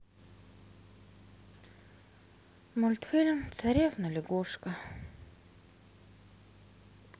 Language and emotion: Russian, sad